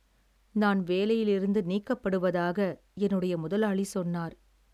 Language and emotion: Tamil, sad